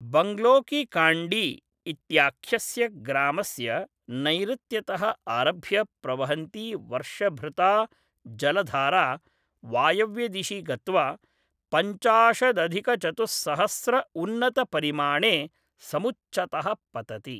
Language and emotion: Sanskrit, neutral